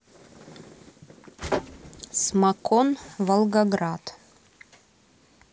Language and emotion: Russian, neutral